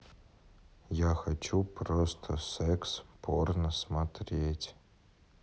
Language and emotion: Russian, neutral